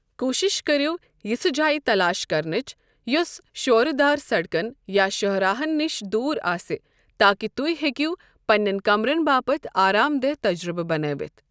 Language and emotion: Kashmiri, neutral